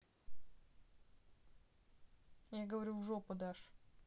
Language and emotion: Russian, neutral